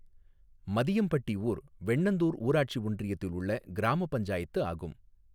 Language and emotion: Tamil, neutral